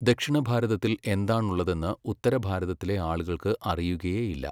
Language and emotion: Malayalam, neutral